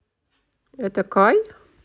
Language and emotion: Russian, positive